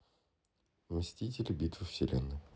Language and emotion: Russian, neutral